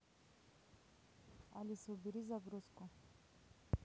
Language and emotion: Russian, neutral